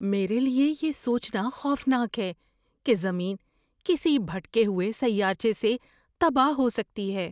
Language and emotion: Urdu, fearful